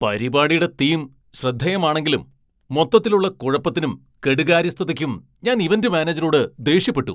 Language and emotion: Malayalam, angry